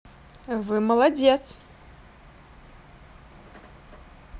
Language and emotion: Russian, positive